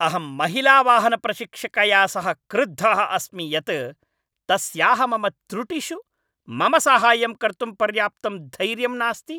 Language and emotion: Sanskrit, angry